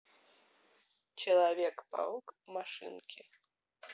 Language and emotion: Russian, neutral